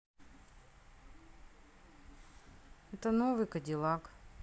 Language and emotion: Russian, neutral